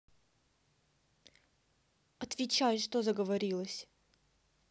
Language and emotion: Russian, angry